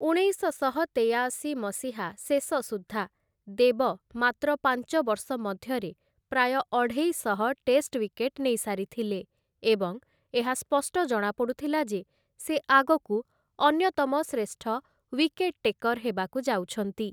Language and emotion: Odia, neutral